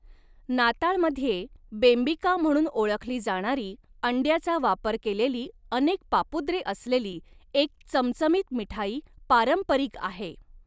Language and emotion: Marathi, neutral